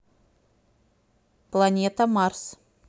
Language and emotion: Russian, neutral